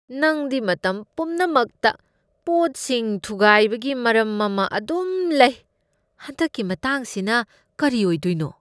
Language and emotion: Manipuri, disgusted